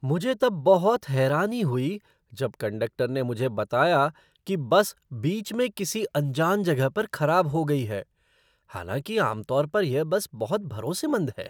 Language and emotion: Hindi, surprised